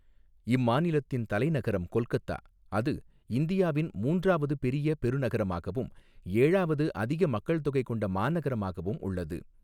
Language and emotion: Tamil, neutral